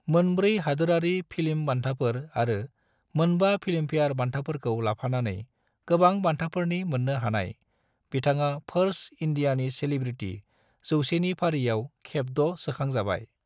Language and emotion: Bodo, neutral